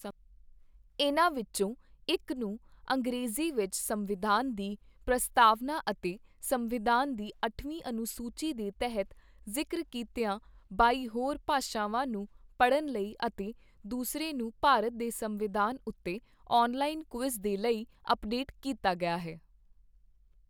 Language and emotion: Punjabi, neutral